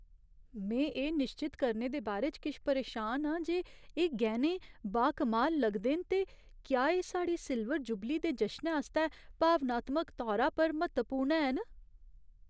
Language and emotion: Dogri, fearful